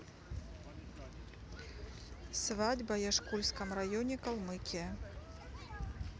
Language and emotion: Russian, neutral